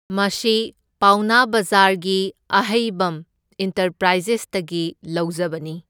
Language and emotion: Manipuri, neutral